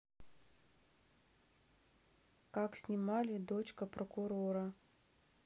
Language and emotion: Russian, neutral